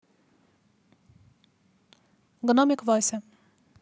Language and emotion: Russian, neutral